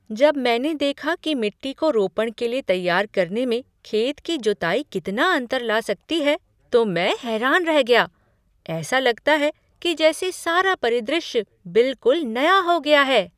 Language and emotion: Hindi, surprised